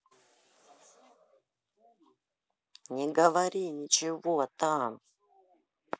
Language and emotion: Russian, neutral